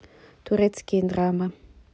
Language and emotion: Russian, neutral